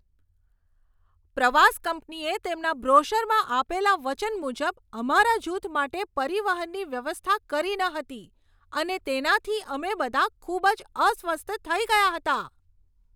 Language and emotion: Gujarati, angry